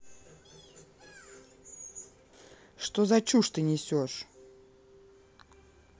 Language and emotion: Russian, neutral